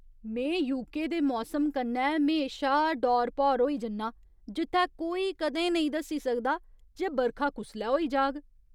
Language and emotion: Dogri, surprised